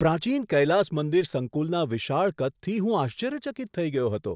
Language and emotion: Gujarati, surprised